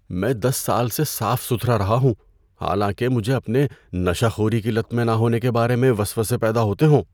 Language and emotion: Urdu, fearful